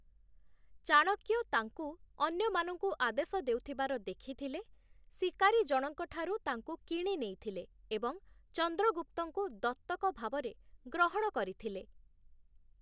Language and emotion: Odia, neutral